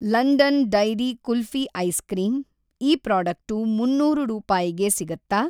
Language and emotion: Kannada, neutral